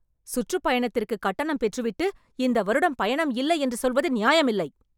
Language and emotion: Tamil, angry